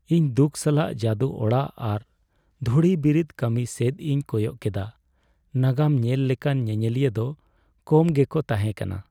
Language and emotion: Santali, sad